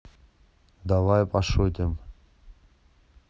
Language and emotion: Russian, neutral